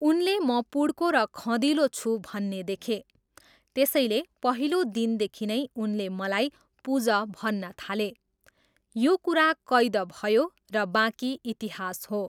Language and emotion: Nepali, neutral